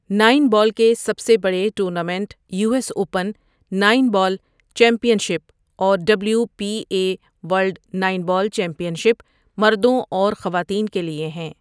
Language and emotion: Urdu, neutral